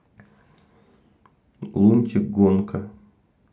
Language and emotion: Russian, neutral